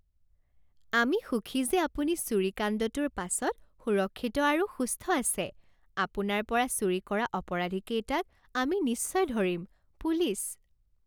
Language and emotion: Assamese, happy